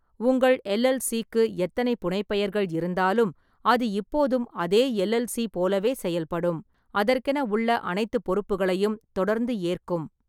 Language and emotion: Tamil, neutral